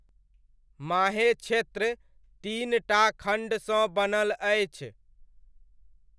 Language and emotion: Maithili, neutral